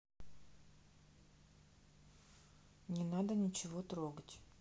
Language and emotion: Russian, neutral